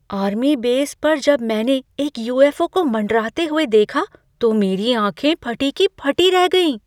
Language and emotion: Hindi, surprised